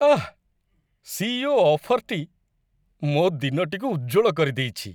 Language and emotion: Odia, happy